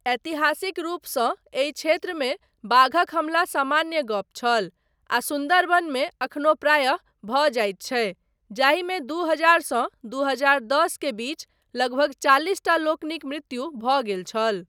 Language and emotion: Maithili, neutral